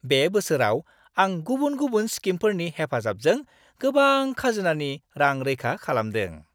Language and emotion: Bodo, happy